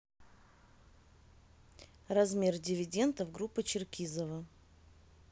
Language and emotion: Russian, neutral